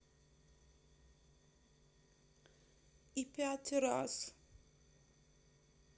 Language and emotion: Russian, sad